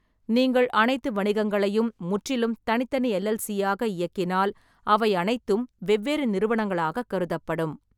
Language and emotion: Tamil, neutral